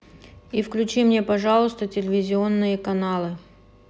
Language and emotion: Russian, neutral